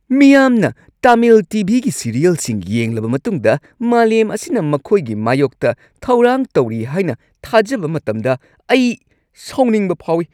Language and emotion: Manipuri, angry